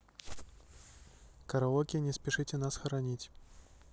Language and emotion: Russian, neutral